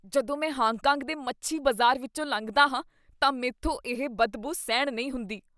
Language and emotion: Punjabi, disgusted